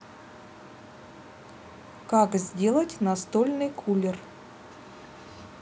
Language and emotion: Russian, neutral